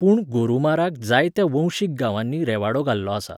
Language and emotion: Goan Konkani, neutral